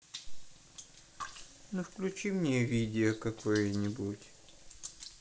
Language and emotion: Russian, sad